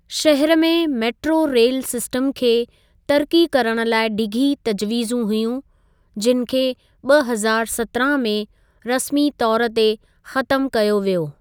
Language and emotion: Sindhi, neutral